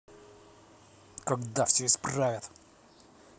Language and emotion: Russian, angry